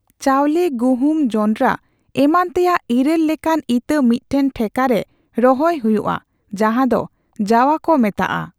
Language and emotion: Santali, neutral